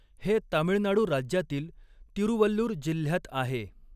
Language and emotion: Marathi, neutral